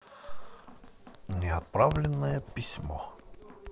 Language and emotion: Russian, neutral